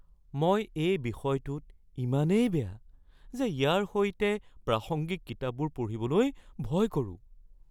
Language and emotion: Assamese, fearful